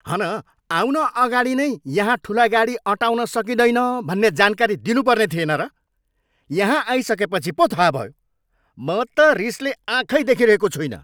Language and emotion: Nepali, angry